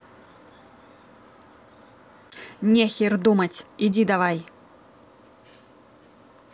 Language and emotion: Russian, angry